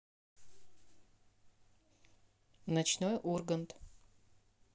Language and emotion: Russian, neutral